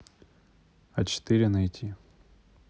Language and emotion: Russian, neutral